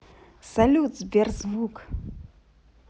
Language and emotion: Russian, positive